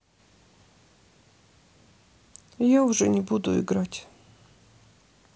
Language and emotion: Russian, sad